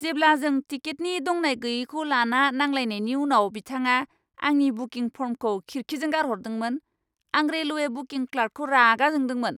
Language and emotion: Bodo, angry